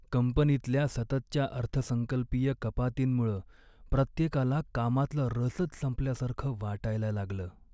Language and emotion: Marathi, sad